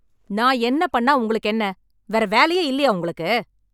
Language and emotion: Tamil, angry